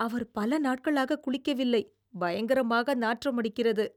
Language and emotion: Tamil, disgusted